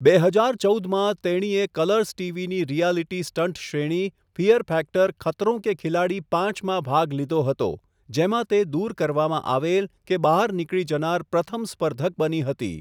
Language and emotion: Gujarati, neutral